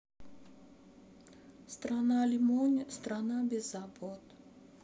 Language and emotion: Russian, sad